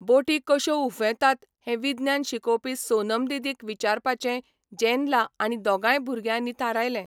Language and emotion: Goan Konkani, neutral